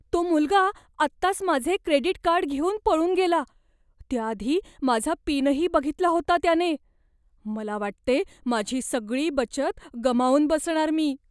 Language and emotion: Marathi, fearful